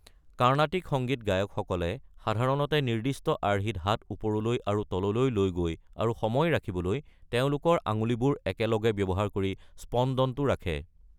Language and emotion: Assamese, neutral